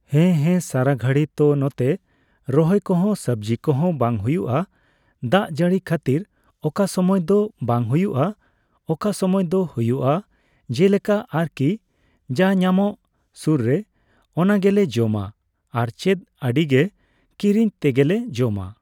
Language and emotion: Santali, neutral